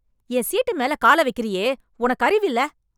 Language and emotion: Tamil, angry